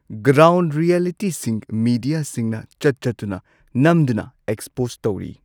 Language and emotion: Manipuri, neutral